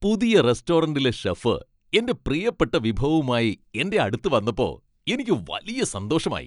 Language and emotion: Malayalam, happy